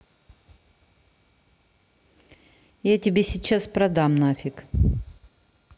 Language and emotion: Russian, angry